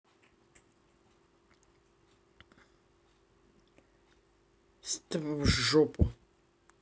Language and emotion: Russian, angry